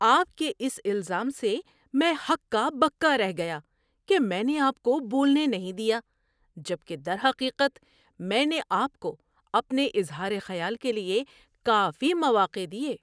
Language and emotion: Urdu, surprised